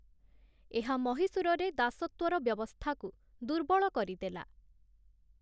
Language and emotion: Odia, neutral